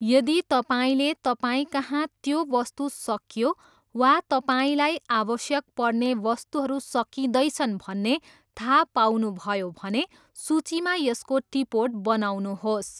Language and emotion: Nepali, neutral